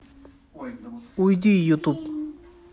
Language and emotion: Russian, neutral